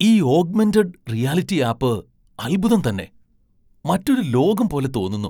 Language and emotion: Malayalam, surprised